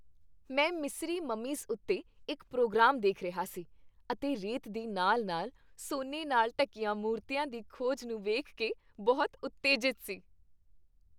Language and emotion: Punjabi, happy